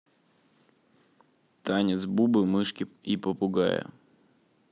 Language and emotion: Russian, neutral